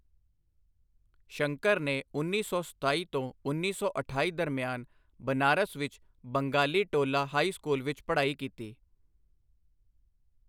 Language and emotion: Punjabi, neutral